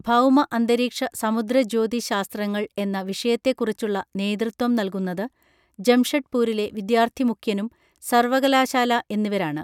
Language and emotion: Malayalam, neutral